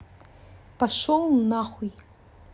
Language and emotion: Russian, angry